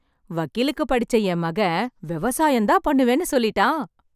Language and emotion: Tamil, happy